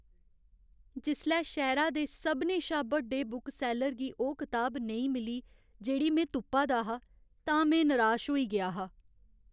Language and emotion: Dogri, sad